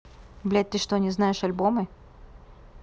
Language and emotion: Russian, angry